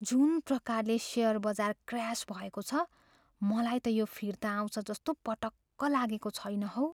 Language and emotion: Nepali, fearful